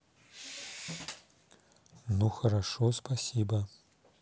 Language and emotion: Russian, neutral